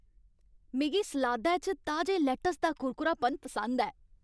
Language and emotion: Dogri, happy